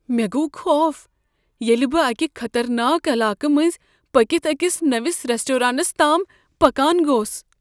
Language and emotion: Kashmiri, fearful